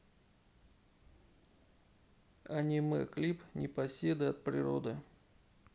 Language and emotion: Russian, neutral